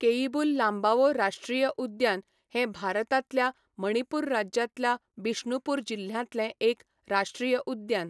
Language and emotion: Goan Konkani, neutral